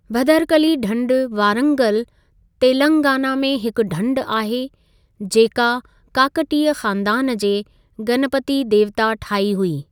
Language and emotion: Sindhi, neutral